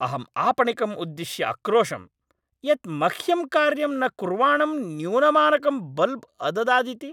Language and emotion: Sanskrit, angry